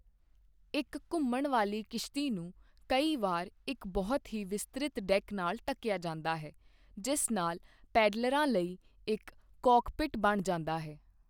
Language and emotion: Punjabi, neutral